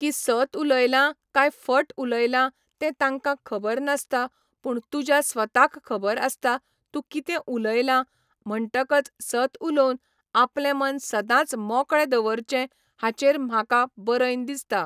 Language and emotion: Goan Konkani, neutral